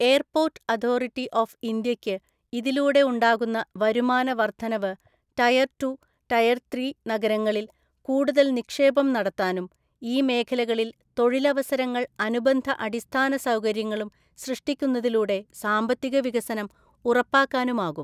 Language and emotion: Malayalam, neutral